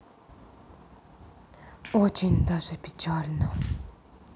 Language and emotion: Russian, sad